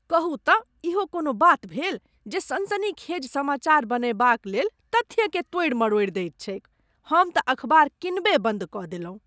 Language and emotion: Maithili, disgusted